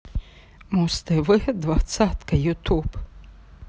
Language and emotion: Russian, positive